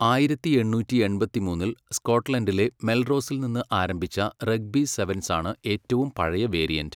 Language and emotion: Malayalam, neutral